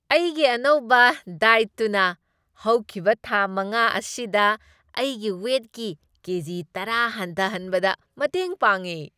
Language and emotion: Manipuri, happy